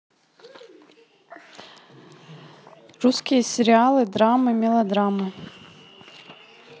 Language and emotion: Russian, neutral